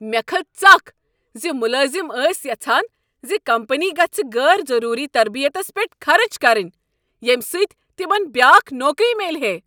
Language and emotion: Kashmiri, angry